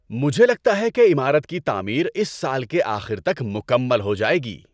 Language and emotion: Urdu, happy